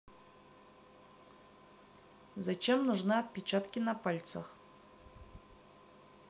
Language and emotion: Russian, neutral